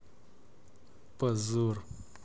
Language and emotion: Russian, angry